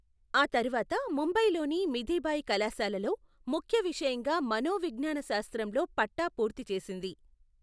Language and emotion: Telugu, neutral